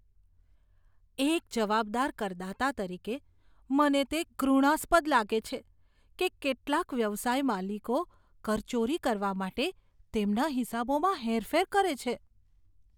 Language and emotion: Gujarati, disgusted